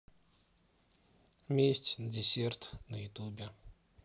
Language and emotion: Russian, sad